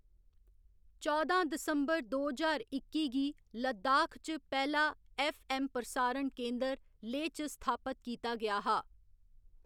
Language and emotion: Dogri, neutral